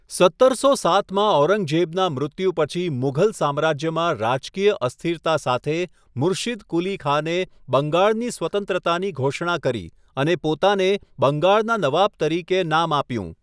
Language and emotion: Gujarati, neutral